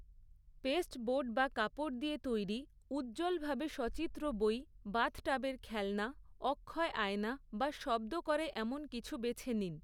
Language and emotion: Bengali, neutral